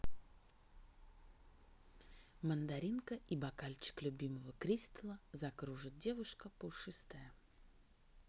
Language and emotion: Russian, neutral